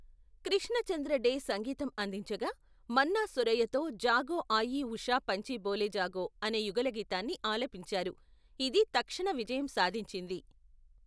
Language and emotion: Telugu, neutral